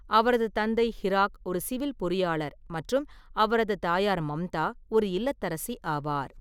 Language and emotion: Tamil, neutral